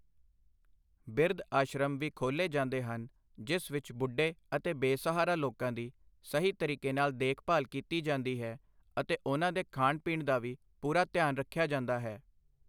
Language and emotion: Punjabi, neutral